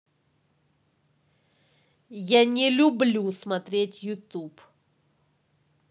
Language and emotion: Russian, angry